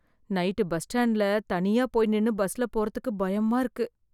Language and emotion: Tamil, fearful